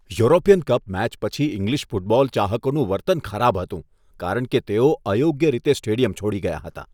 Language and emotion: Gujarati, disgusted